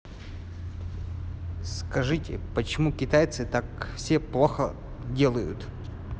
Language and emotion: Russian, neutral